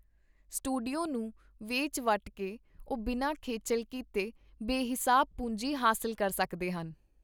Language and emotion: Punjabi, neutral